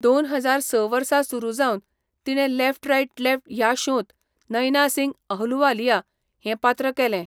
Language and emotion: Goan Konkani, neutral